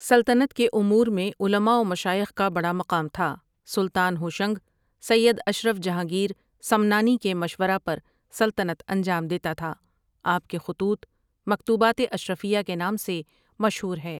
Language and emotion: Urdu, neutral